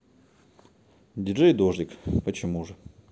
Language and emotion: Russian, neutral